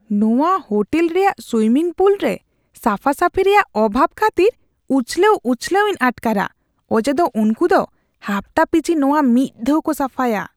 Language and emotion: Santali, disgusted